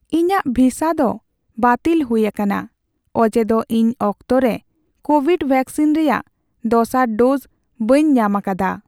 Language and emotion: Santali, sad